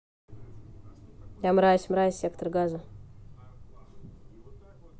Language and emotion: Russian, neutral